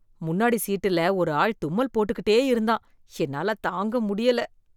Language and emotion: Tamil, disgusted